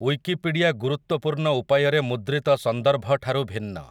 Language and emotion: Odia, neutral